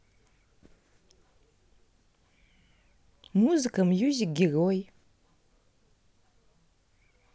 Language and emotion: Russian, neutral